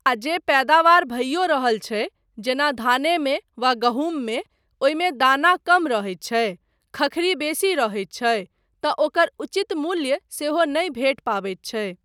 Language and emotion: Maithili, neutral